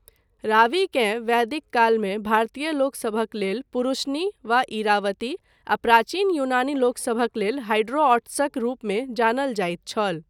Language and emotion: Maithili, neutral